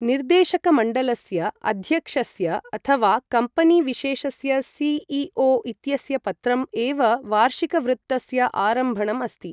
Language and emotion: Sanskrit, neutral